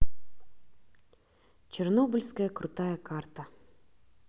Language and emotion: Russian, neutral